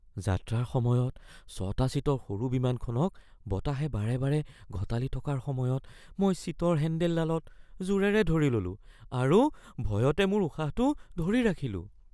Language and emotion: Assamese, fearful